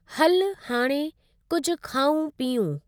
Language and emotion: Sindhi, neutral